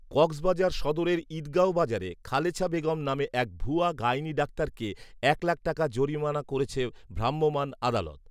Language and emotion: Bengali, neutral